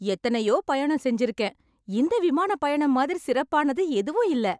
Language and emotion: Tamil, happy